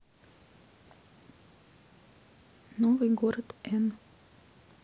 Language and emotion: Russian, neutral